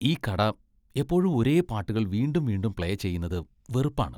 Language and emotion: Malayalam, disgusted